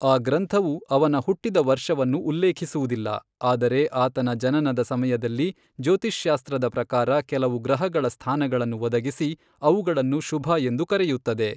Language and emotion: Kannada, neutral